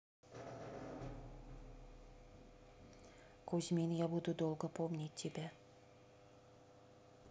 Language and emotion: Russian, sad